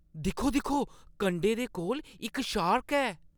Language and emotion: Dogri, surprised